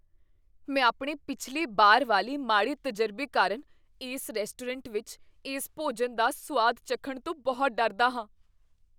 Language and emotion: Punjabi, fearful